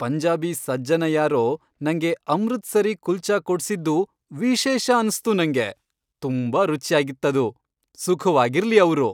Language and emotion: Kannada, happy